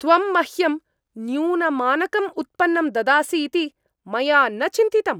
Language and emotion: Sanskrit, angry